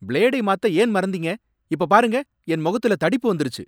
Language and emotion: Tamil, angry